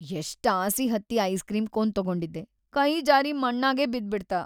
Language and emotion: Kannada, sad